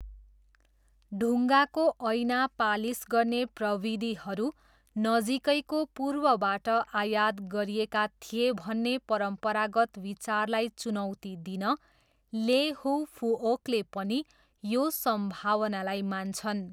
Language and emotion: Nepali, neutral